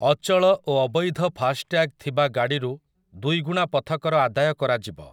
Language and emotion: Odia, neutral